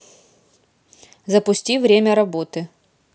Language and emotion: Russian, neutral